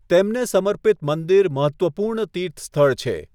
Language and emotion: Gujarati, neutral